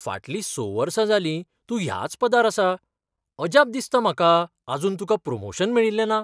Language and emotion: Goan Konkani, surprised